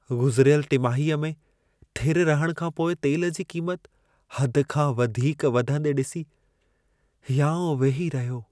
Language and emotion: Sindhi, sad